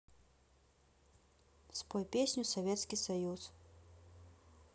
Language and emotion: Russian, neutral